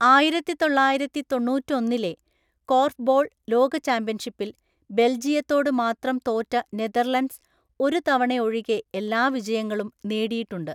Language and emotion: Malayalam, neutral